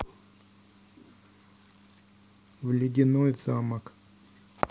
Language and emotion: Russian, neutral